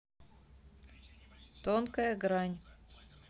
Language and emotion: Russian, neutral